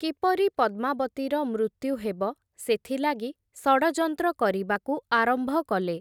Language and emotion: Odia, neutral